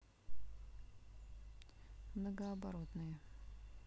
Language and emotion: Russian, neutral